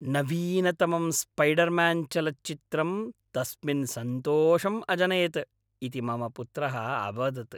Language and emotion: Sanskrit, happy